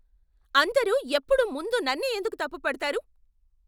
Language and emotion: Telugu, angry